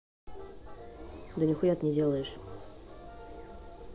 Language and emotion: Russian, angry